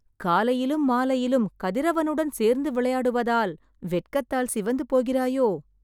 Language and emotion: Tamil, surprised